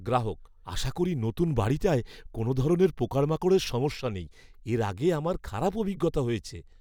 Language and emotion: Bengali, fearful